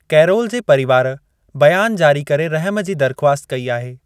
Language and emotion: Sindhi, neutral